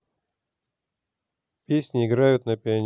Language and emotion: Russian, neutral